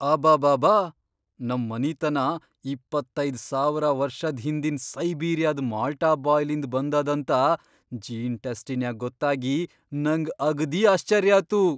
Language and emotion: Kannada, surprised